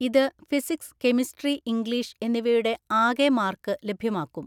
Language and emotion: Malayalam, neutral